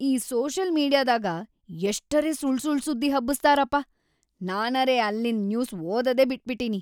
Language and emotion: Kannada, angry